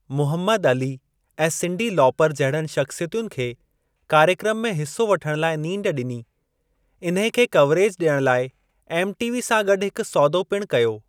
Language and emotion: Sindhi, neutral